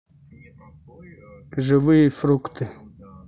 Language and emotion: Russian, neutral